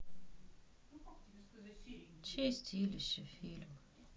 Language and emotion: Russian, sad